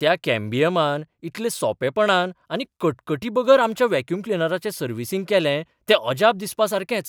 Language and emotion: Goan Konkani, surprised